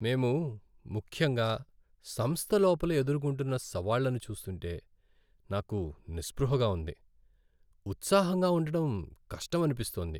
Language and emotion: Telugu, sad